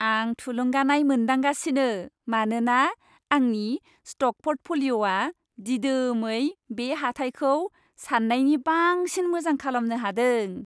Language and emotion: Bodo, happy